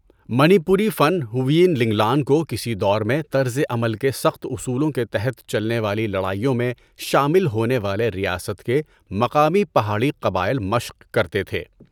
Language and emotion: Urdu, neutral